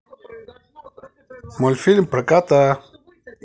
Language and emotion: Russian, positive